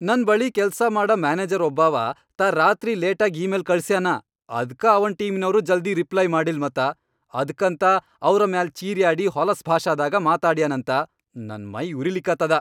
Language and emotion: Kannada, angry